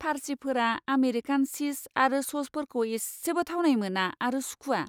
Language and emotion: Bodo, disgusted